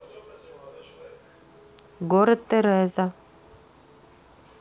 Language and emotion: Russian, neutral